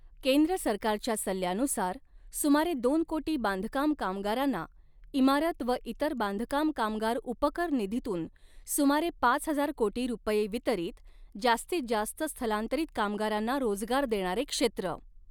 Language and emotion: Marathi, neutral